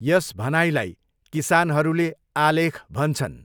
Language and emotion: Nepali, neutral